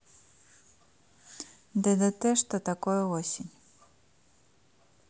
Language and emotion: Russian, neutral